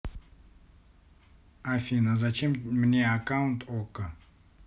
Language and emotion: Russian, neutral